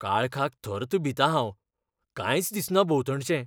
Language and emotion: Goan Konkani, fearful